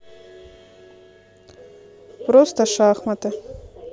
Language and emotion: Russian, neutral